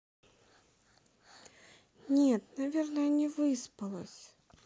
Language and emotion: Russian, sad